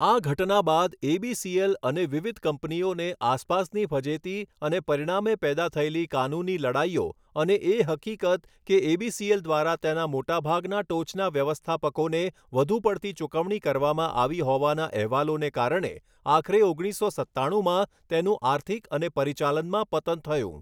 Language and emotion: Gujarati, neutral